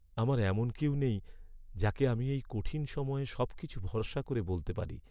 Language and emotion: Bengali, sad